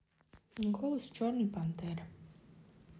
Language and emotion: Russian, neutral